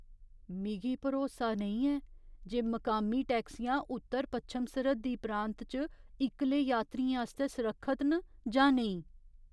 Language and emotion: Dogri, fearful